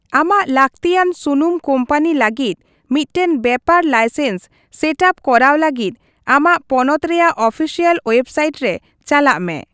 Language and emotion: Santali, neutral